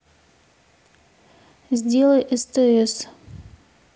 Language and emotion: Russian, neutral